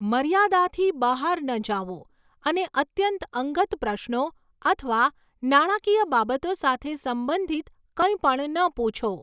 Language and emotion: Gujarati, neutral